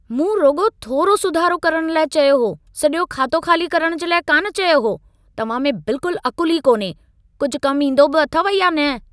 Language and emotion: Sindhi, angry